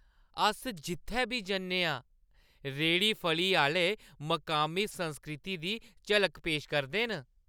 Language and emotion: Dogri, happy